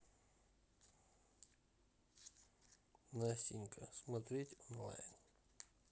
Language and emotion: Russian, neutral